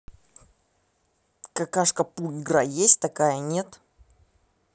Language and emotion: Russian, neutral